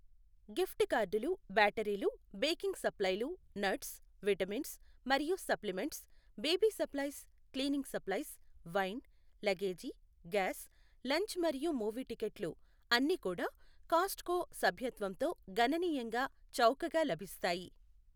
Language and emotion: Telugu, neutral